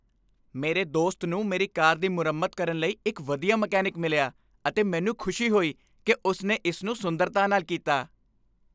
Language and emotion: Punjabi, happy